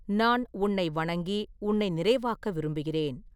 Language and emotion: Tamil, neutral